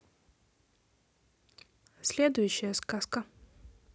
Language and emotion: Russian, neutral